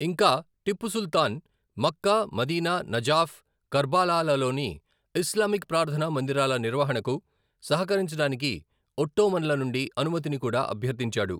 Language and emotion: Telugu, neutral